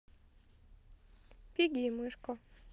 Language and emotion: Russian, neutral